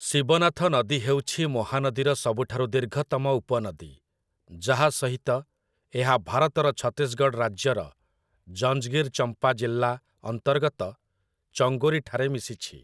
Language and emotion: Odia, neutral